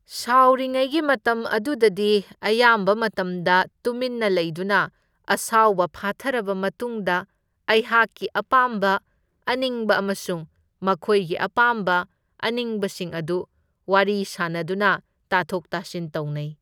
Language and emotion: Manipuri, neutral